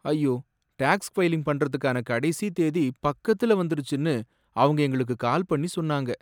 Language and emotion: Tamil, sad